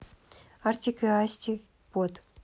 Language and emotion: Russian, neutral